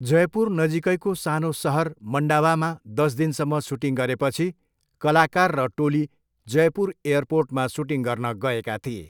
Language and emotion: Nepali, neutral